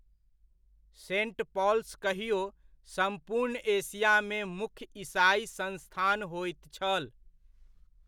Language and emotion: Maithili, neutral